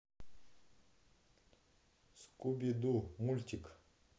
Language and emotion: Russian, neutral